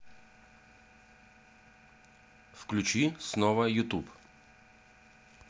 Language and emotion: Russian, neutral